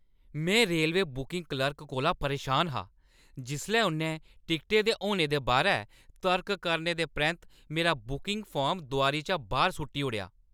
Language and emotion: Dogri, angry